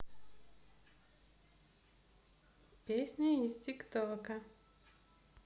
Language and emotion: Russian, positive